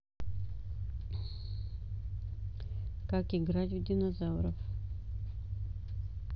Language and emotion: Russian, neutral